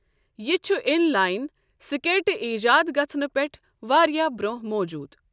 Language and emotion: Kashmiri, neutral